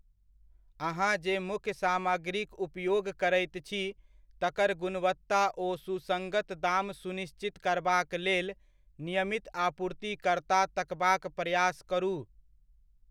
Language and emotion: Maithili, neutral